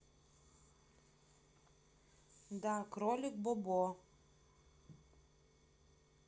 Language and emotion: Russian, neutral